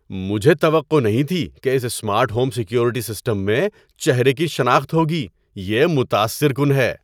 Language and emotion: Urdu, surprised